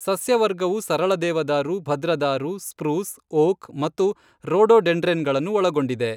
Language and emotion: Kannada, neutral